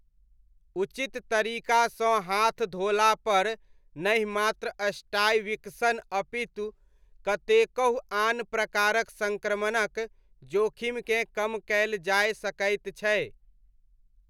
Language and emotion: Maithili, neutral